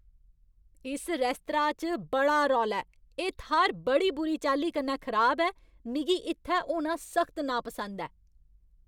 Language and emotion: Dogri, angry